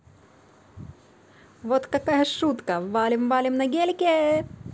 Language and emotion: Russian, positive